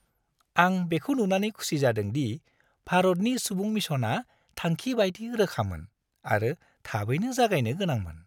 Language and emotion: Bodo, happy